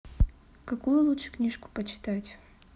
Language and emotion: Russian, neutral